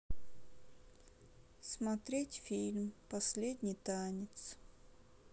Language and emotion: Russian, sad